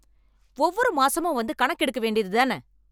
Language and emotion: Tamil, angry